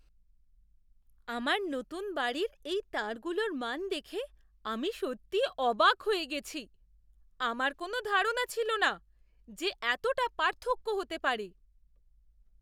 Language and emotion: Bengali, surprised